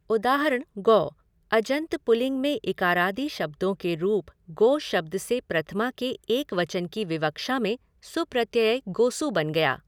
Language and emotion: Hindi, neutral